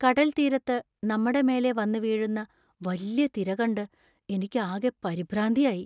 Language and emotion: Malayalam, fearful